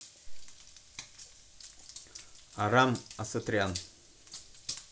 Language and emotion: Russian, neutral